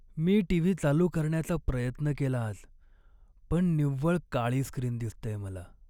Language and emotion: Marathi, sad